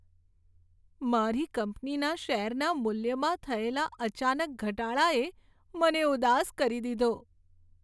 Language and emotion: Gujarati, sad